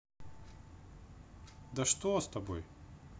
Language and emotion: Russian, neutral